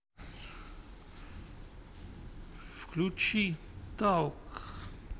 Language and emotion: Russian, neutral